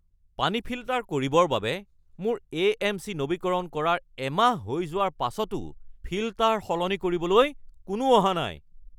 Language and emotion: Assamese, angry